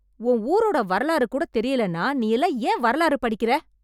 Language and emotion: Tamil, angry